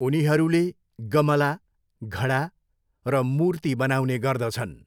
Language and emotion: Nepali, neutral